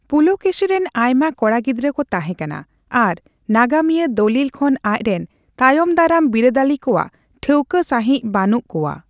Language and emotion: Santali, neutral